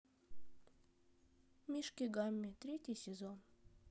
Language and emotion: Russian, neutral